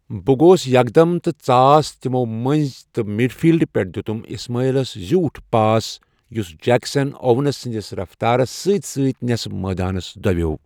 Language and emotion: Kashmiri, neutral